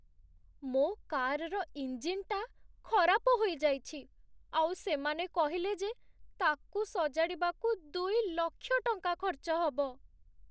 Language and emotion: Odia, sad